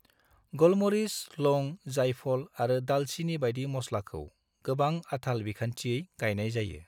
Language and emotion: Bodo, neutral